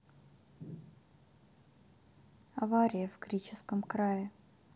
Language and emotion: Russian, sad